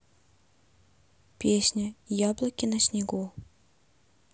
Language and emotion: Russian, neutral